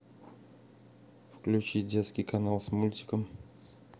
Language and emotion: Russian, neutral